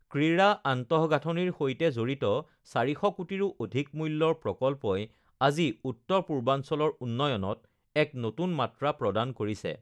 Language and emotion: Assamese, neutral